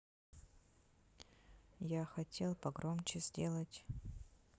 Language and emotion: Russian, neutral